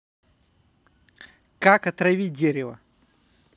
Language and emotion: Russian, neutral